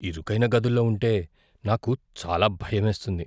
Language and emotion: Telugu, fearful